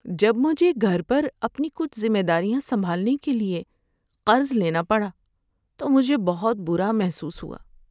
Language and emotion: Urdu, sad